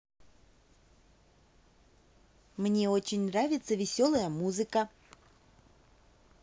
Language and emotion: Russian, positive